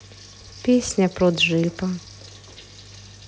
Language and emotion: Russian, neutral